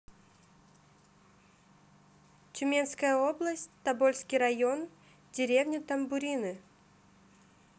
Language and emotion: Russian, neutral